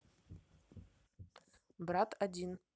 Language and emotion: Russian, neutral